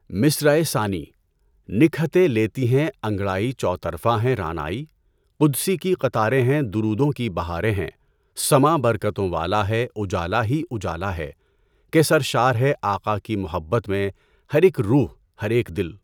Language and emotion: Urdu, neutral